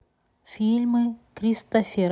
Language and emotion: Russian, neutral